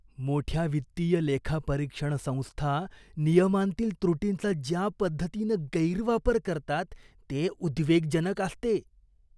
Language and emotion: Marathi, disgusted